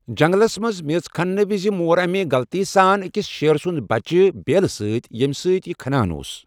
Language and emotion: Kashmiri, neutral